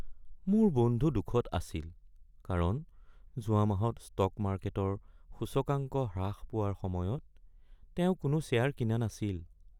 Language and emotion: Assamese, sad